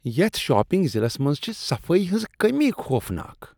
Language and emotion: Kashmiri, disgusted